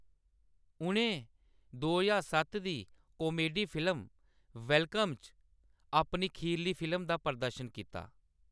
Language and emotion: Dogri, neutral